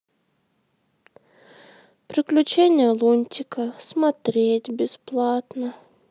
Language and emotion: Russian, sad